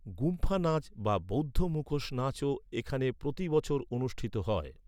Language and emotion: Bengali, neutral